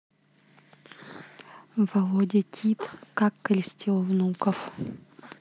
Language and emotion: Russian, neutral